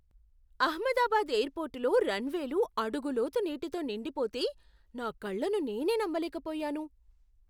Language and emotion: Telugu, surprised